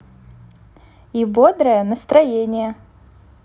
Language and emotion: Russian, positive